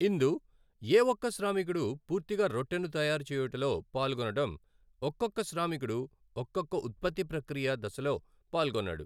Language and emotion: Telugu, neutral